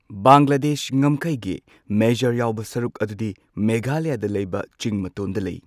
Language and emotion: Manipuri, neutral